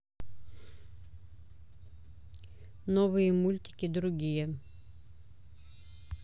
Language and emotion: Russian, neutral